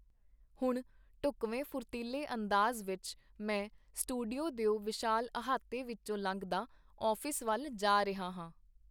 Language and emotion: Punjabi, neutral